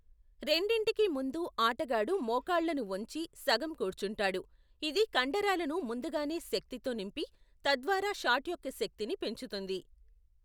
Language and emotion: Telugu, neutral